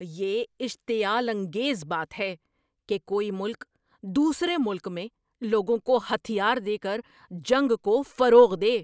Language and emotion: Urdu, angry